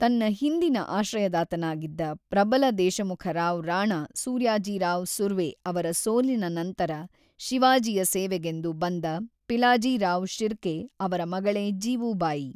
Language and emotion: Kannada, neutral